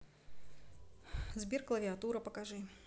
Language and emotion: Russian, neutral